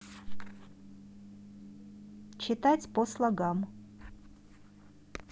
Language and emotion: Russian, neutral